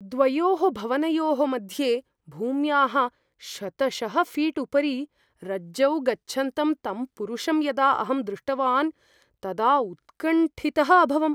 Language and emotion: Sanskrit, fearful